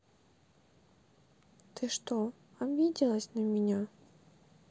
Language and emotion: Russian, sad